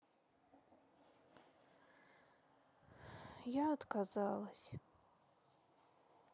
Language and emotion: Russian, sad